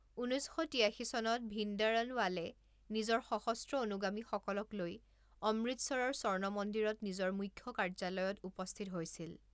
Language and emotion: Assamese, neutral